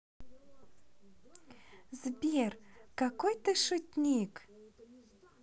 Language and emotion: Russian, positive